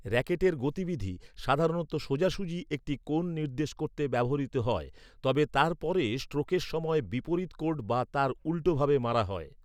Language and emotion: Bengali, neutral